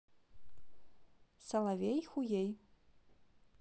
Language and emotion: Russian, neutral